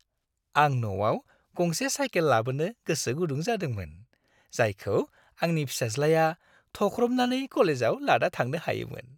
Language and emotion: Bodo, happy